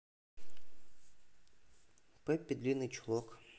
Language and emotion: Russian, neutral